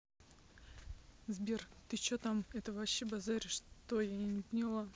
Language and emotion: Russian, neutral